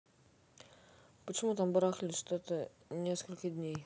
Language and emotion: Russian, neutral